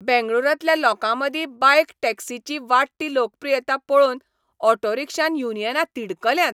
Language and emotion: Goan Konkani, angry